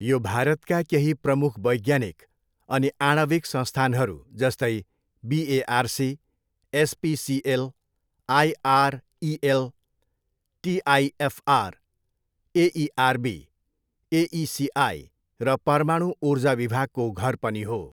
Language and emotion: Nepali, neutral